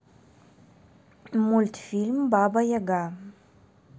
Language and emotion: Russian, neutral